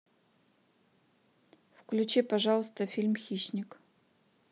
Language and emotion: Russian, neutral